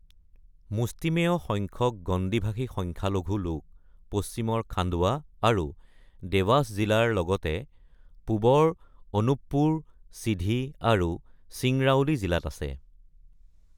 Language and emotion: Assamese, neutral